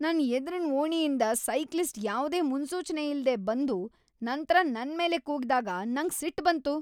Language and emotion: Kannada, angry